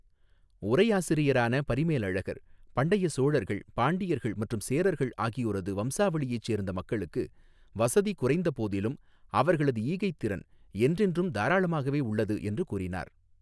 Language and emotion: Tamil, neutral